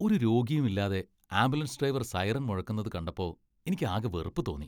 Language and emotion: Malayalam, disgusted